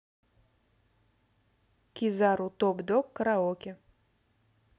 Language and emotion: Russian, neutral